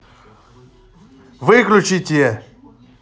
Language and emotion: Russian, angry